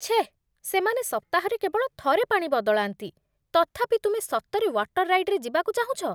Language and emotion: Odia, disgusted